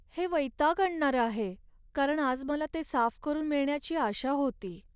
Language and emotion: Marathi, sad